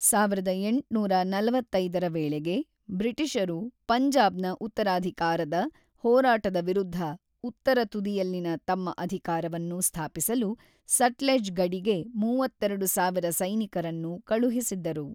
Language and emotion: Kannada, neutral